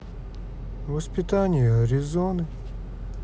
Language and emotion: Russian, neutral